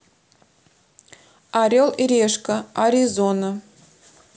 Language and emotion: Russian, neutral